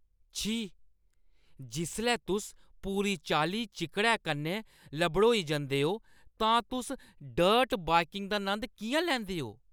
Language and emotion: Dogri, disgusted